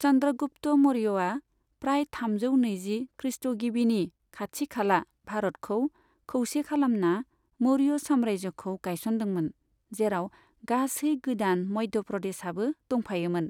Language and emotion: Bodo, neutral